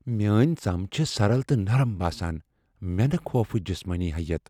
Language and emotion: Kashmiri, fearful